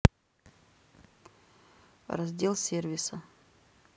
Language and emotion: Russian, neutral